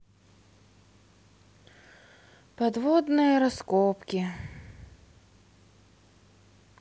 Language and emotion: Russian, sad